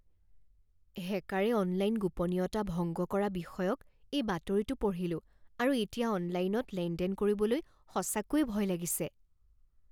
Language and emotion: Assamese, fearful